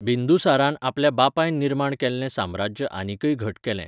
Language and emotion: Goan Konkani, neutral